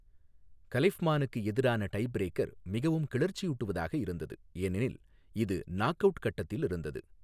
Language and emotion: Tamil, neutral